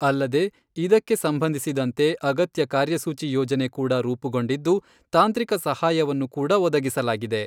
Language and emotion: Kannada, neutral